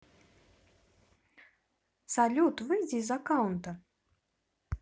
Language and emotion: Russian, neutral